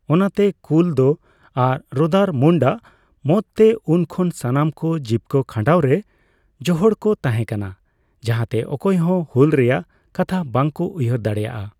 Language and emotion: Santali, neutral